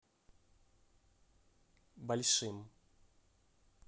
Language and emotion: Russian, neutral